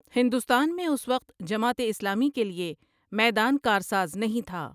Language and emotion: Urdu, neutral